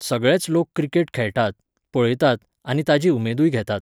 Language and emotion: Goan Konkani, neutral